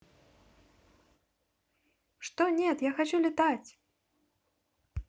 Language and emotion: Russian, positive